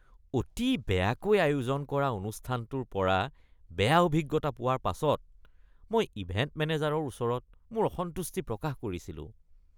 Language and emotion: Assamese, disgusted